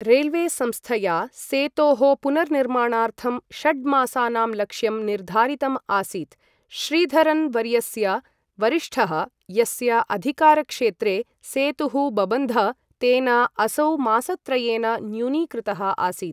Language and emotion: Sanskrit, neutral